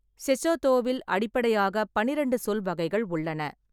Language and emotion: Tamil, neutral